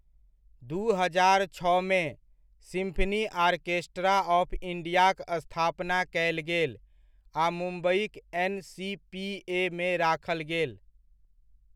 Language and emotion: Maithili, neutral